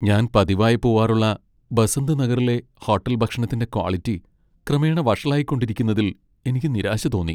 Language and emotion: Malayalam, sad